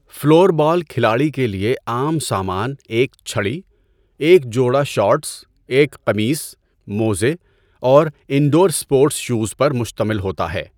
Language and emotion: Urdu, neutral